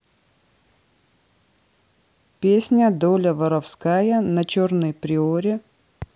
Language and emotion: Russian, neutral